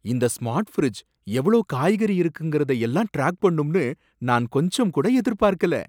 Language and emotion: Tamil, surprised